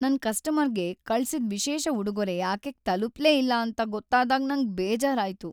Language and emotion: Kannada, sad